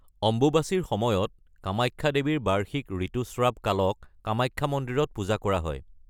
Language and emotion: Assamese, neutral